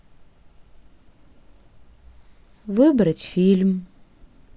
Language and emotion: Russian, sad